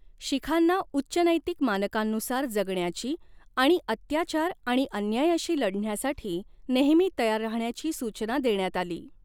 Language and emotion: Marathi, neutral